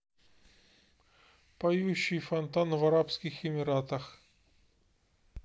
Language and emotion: Russian, neutral